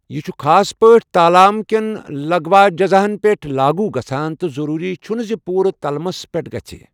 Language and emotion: Kashmiri, neutral